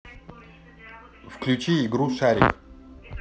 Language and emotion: Russian, neutral